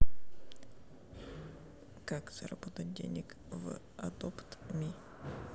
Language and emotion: Russian, neutral